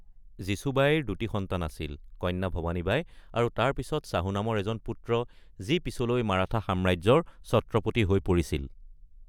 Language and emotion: Assamese, neutral